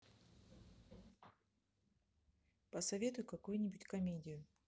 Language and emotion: Russian, neutral